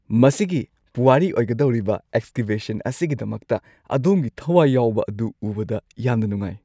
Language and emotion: Manipuri, happy